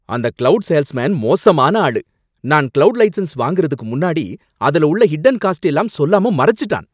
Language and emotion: Tamil, angry